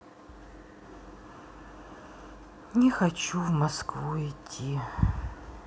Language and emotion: Russian, sad